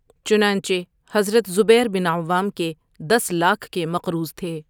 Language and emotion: Urdu, neutral